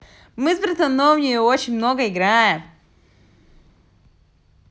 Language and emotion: Russian, positive